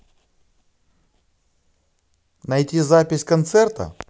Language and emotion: Russian, positive